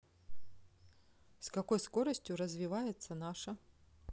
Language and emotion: Russian, neutral